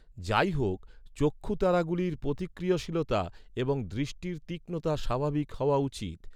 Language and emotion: Bengali, neutral